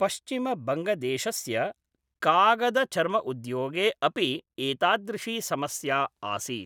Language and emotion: Sanskrit, neutral